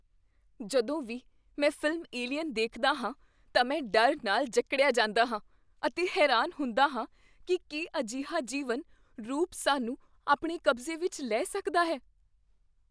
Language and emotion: Punjabi, fearful